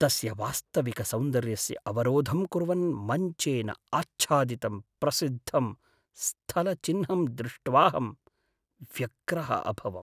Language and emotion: Sanskrit, sad